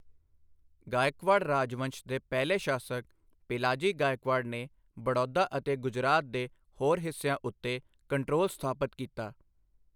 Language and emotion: Punjabi, neutral